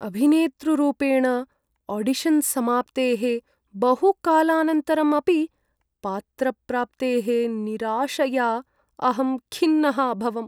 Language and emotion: Sanskrit, sad